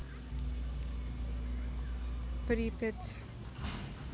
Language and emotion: Russian, neutral